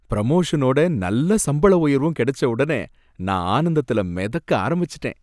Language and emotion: Tamil, happy